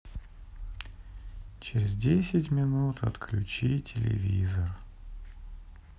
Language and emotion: Russian, sad